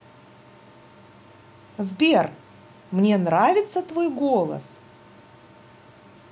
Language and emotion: Russian, positive